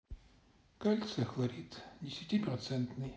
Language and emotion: Russian, sad